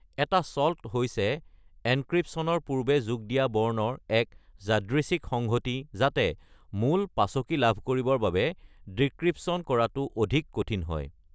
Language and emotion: Assamese, neutral